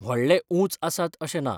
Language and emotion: Goan Konkani, neutral